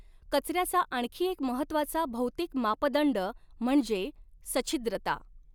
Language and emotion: Marathi, neutral